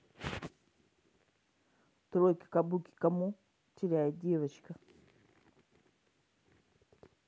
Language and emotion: Russian, neutral